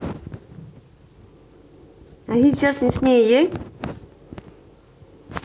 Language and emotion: Russian, positive